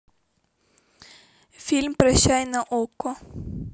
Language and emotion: Russian, neutral